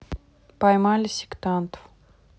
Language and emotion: Russian, neutral